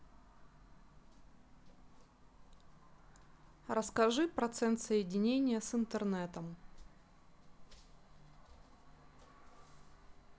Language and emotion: Russian, neutral